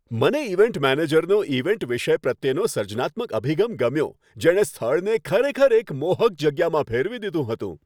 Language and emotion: Gujarati, happy